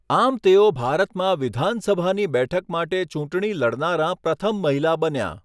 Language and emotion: Gujarati, neutral